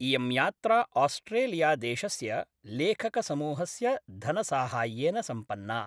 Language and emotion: Sanskrit, neutral